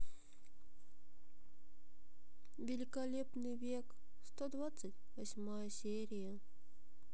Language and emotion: Russian, sad